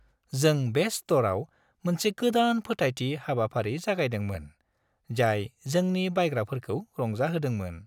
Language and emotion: Bodo, happy